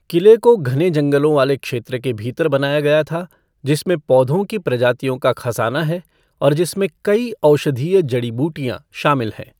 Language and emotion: Hindi, neutral